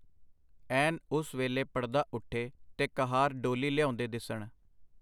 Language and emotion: Punjabi, neutral